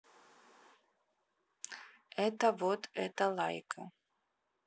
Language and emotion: Russian, neutral